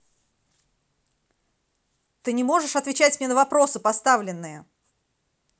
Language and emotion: Russian, angry